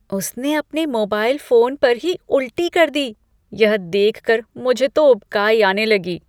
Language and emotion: Hindi, disgusted